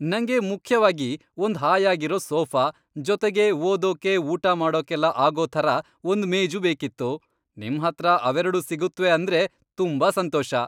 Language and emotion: Kannada, happy